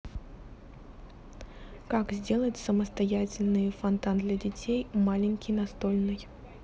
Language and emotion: Russian, neutral